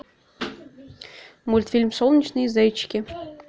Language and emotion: Russian, neutral